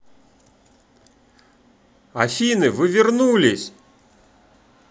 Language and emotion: Russian, positive